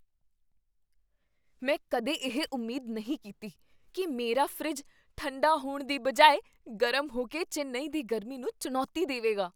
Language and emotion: Punjabi, surprised